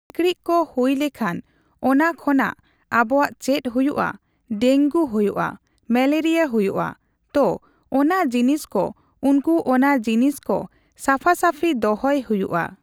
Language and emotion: Santali, neutral